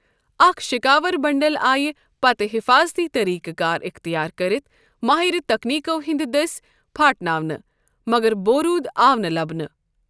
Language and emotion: Kashmiri, neutral